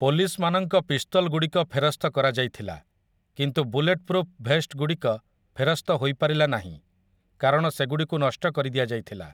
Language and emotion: Odia, neutral